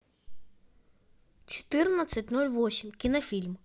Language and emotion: Russian, neutral